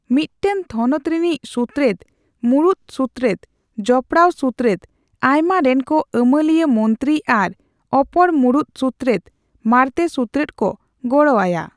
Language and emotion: Santali, neutral